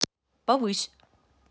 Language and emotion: Russian, neutral